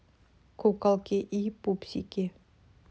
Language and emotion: Russian, neutral